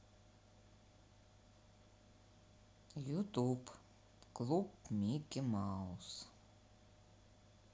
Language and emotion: Russian, neutral